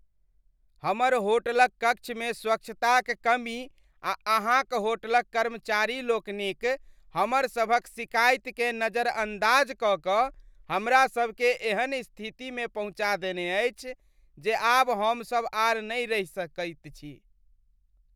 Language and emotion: Maithili, disgusted